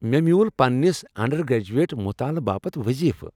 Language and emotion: Kashmiri, happy